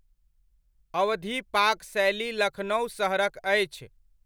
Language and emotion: Maithili, neutral